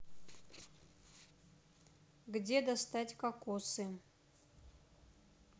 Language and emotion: Russian, neutral